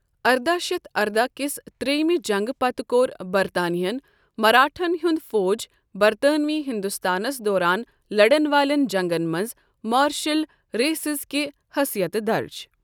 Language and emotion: Kashmiri, neutral